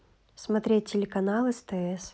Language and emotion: Russian, neutral